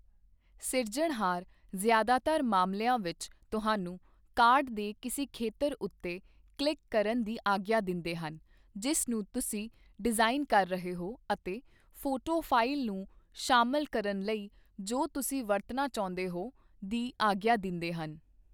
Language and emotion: Punjabi, neutral